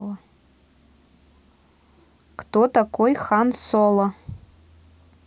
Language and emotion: Russian, neutral